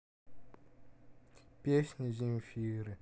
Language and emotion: Russian, sad